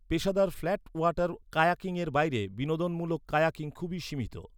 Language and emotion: Bengali, neutral